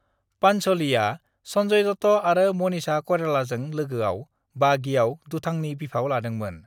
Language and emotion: Bodo, neutral